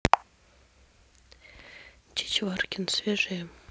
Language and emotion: Russian, neutral